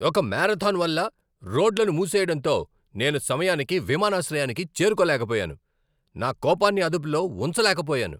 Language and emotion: Telugu, angry